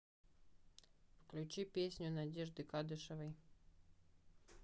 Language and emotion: Russian, neutral